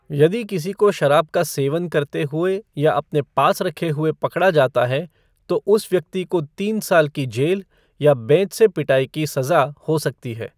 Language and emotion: Hindi, neutral